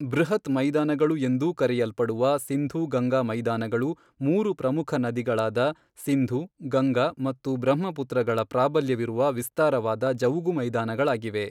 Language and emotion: Kannada, neutral